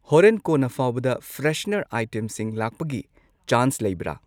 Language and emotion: Manipuri, neutral